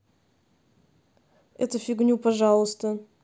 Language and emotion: Russian, neutral